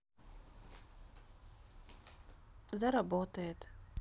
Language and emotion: Russian, sad